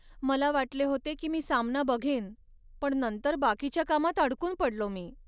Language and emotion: Marathi, sad